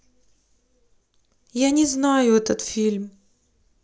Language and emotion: Russian, sad